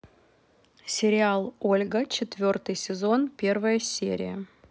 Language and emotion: Russian, neutral